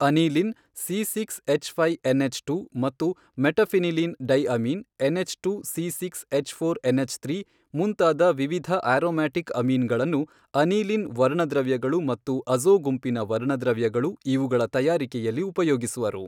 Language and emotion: Kannada, neutral